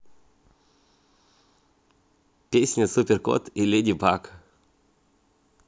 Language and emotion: Russian, positive